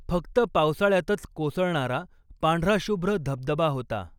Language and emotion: Marathi, neutral